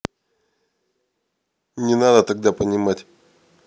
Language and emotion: Russian, angry